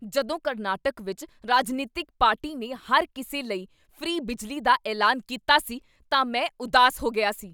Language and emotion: Punjabi, angry